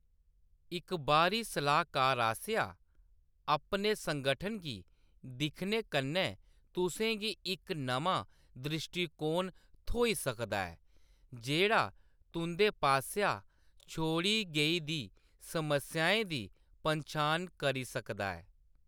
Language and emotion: Dogri, neutral